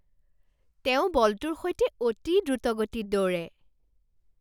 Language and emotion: Assamese, surprised